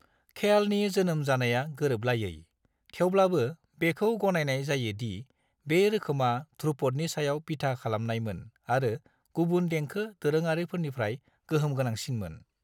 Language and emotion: Bodo, neutral